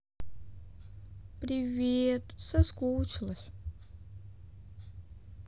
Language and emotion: Russian, sad